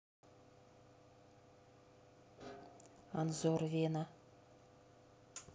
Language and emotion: Russian, neutral